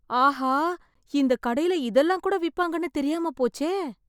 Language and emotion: Tamil, surprised